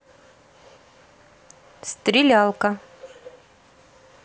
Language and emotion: Russian, neutral